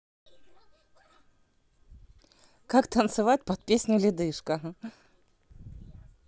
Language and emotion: Russian, positive